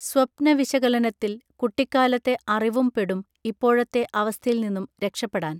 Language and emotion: Malayalam, neutral